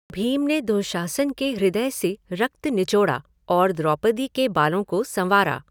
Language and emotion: Hindi, neutral